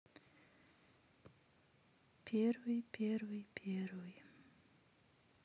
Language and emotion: Russian, sad